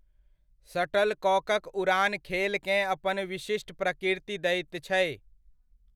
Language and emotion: Maithili, neutral